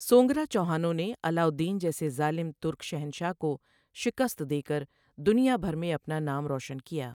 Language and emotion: Urdu, neutral